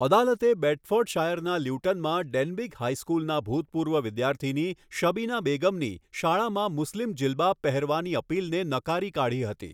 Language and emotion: Gujarati, neutral